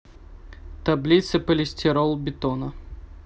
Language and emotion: Russian, neutral